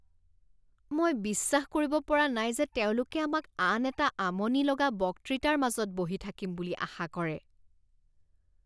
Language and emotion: Assamese, disgusted